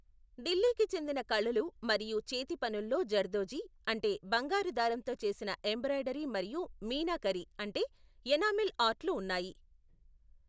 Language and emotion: Telugu, neutral